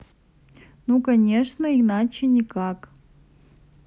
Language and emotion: Russian, neutral